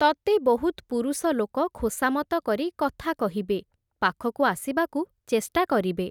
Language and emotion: Odia, neutral